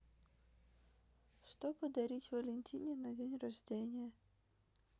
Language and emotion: Russian, neutral